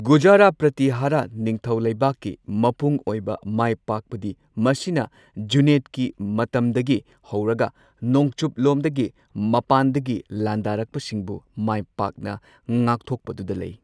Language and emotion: Manipuri, neutral